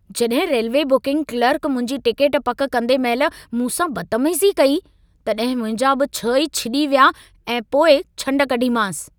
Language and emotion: Sindhi, angry